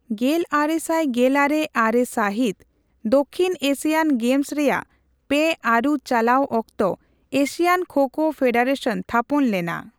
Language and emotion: Santali, neutral